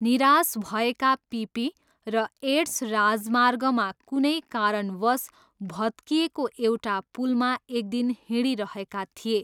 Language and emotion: Nepali, neutral